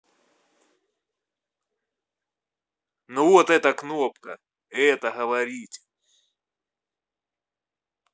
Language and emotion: Russian, angry